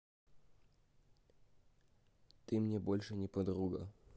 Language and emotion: Russian, neutral